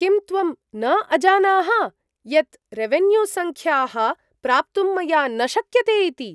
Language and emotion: Sanskrit, surprised